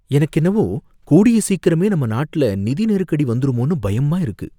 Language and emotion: Tamil, fearful